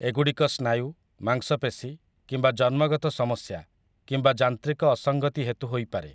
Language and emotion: Odia, neutral